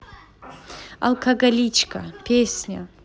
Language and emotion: Russian, positive